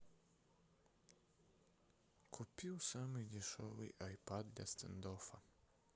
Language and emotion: Russian, sad